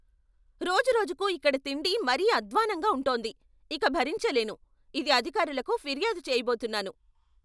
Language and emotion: Telugu, angry